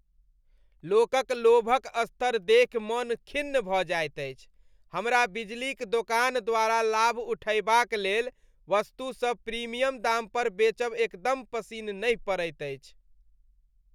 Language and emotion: Maithili, disgusted